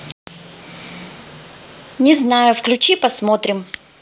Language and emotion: Russian, neutral